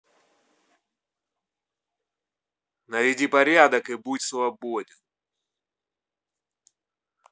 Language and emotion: Russian, angry